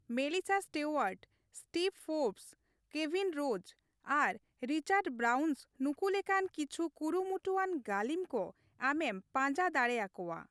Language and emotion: Santali, neutral